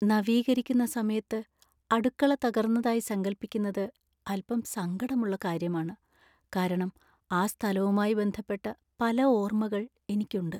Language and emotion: Malayalam, sad